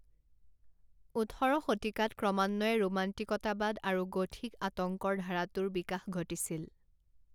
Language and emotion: Assamese, neutral